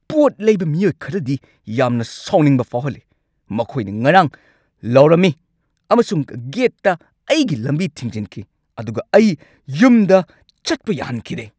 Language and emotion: Manipuri, angry